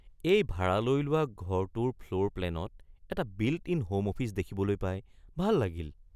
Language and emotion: Assamese, surprised